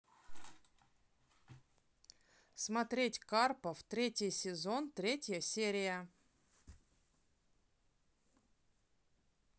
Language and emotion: Russian, neutral